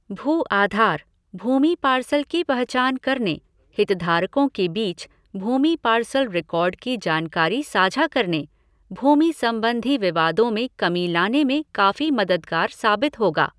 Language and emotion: Hindi, neutral